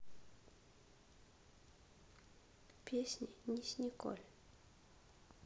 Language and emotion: Russian, sad